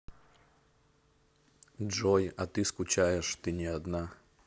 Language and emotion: Russian, neutral